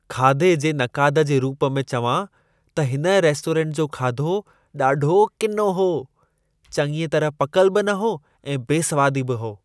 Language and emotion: Sindhi, disgusted